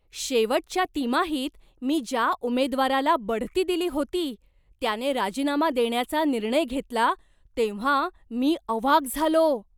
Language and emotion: Marathi, surprised